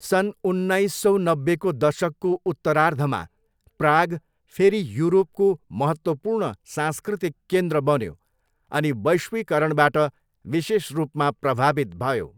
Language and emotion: Nepali, neutral